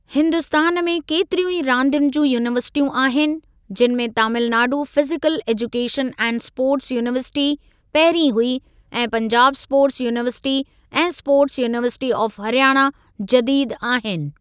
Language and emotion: Sindhi, neutral